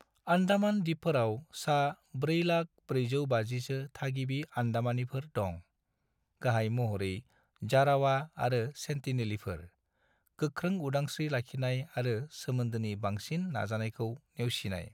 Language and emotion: Bodo, neutral